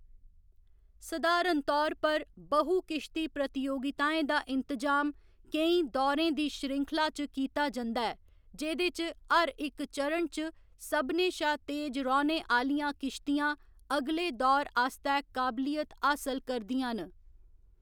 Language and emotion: Dogri, neutral